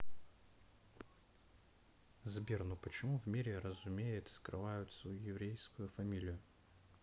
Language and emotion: Russian, neutral